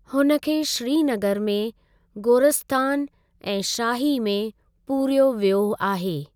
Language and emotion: Sindhi, neutral